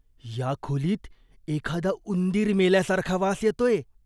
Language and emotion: Marathi, disgusted